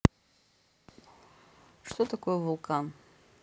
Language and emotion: Russian, neutral